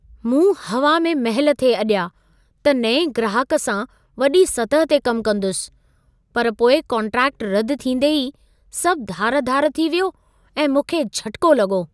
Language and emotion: Sindhi, surprised